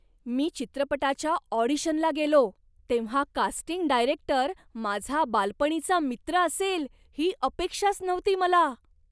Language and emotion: Marathi, surprised